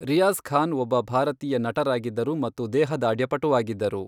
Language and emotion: Kannada, neutral